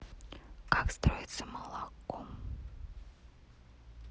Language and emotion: Russian, neutral